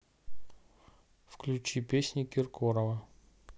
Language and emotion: Russian, neutral